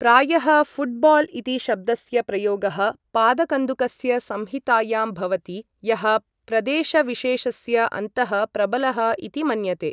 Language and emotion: Sanskrit, neutral